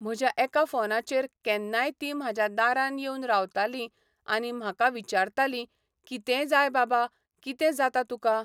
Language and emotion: Goan Konkani, neutral